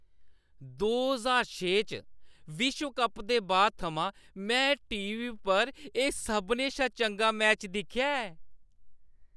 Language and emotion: Dogri, happy